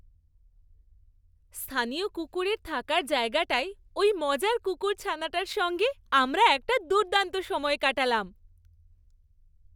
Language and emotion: Bengali, happy